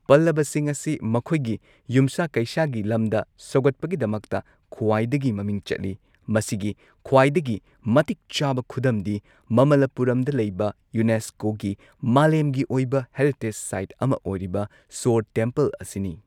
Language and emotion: Manipuri, neutral